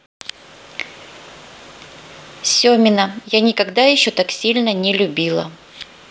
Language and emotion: Russian, neutral